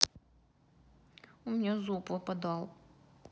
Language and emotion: Russian, sad